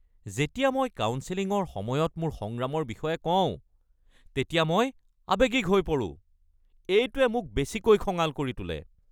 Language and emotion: Assamese, angry